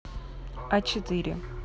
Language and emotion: Russian, neutral